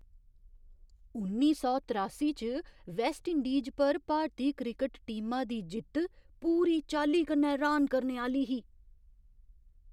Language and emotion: Dogri, surprised